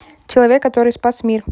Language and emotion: Russian, neutral